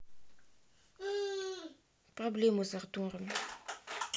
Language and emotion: Russian, sad